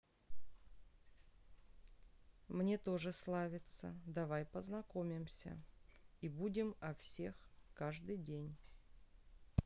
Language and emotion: Russian, neutral